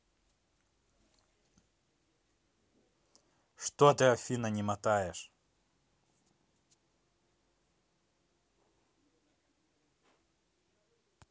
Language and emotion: Russian, angry